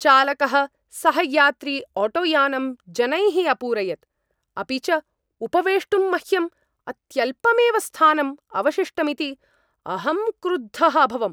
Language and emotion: Sanskrit, angry